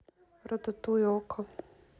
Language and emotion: Russian, neutral